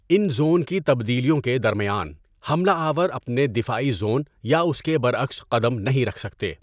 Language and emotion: Urdu, neutral